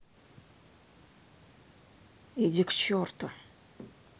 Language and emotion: Russian, angry